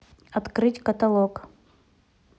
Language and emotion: Russian, neutral